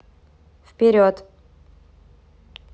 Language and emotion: Russian, neutral